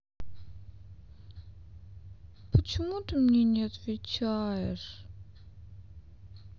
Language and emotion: Russian, sad